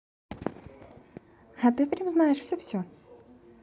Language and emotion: Russian, positive